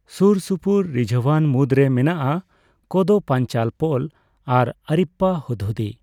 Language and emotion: Santali, neutral